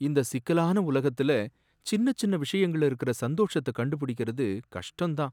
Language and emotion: Tamil, sad